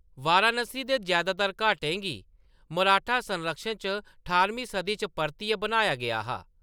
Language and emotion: Dogri, neutral